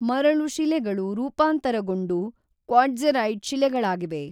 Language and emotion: Kannada, neutral